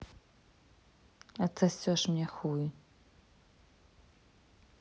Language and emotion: Russian, neutral